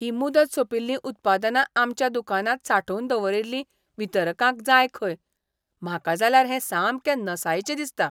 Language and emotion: Goan Konkani, disgusted